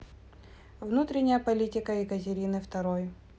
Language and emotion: Russian, neutral